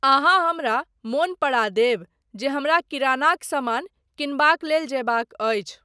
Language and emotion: Maithili, neutral